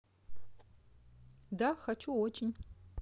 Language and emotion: Russian, neutral